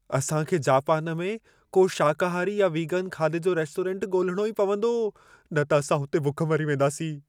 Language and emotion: Sindhi, fearful